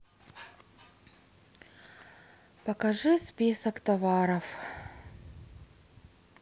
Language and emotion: Russian, sad